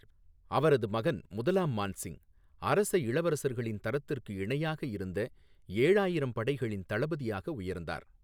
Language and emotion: Tamil, neutral